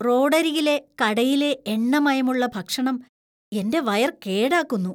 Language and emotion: Malayalam, disgusted